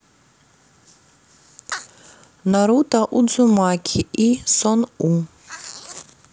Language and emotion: Russian, neutral